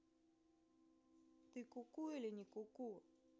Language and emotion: Russian, neutral